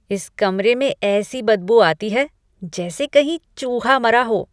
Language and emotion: Hindi, disgusted